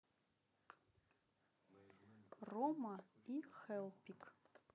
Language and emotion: Russian, neutral